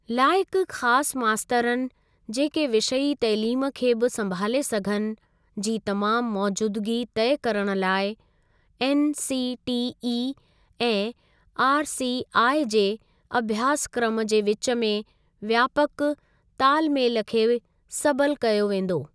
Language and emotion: Sindhi, neutral